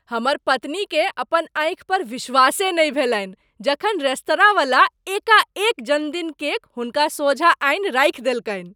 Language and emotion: Maithili, surprised